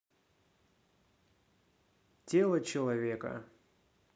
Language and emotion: Russian, neutral